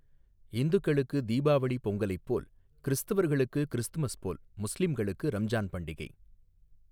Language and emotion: Tamil, neutral